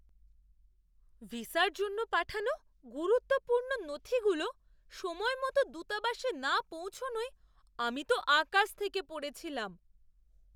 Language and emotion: Bengali, surprised